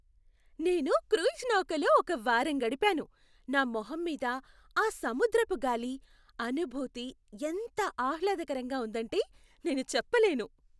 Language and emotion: Telugu, happy